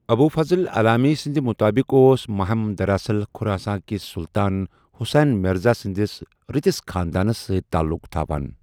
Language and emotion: Kashmiri, neutral